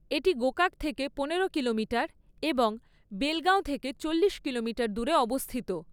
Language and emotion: Bengali, neutral